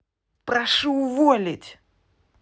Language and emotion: Russian, angry